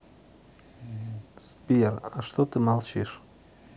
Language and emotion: Russian, neutral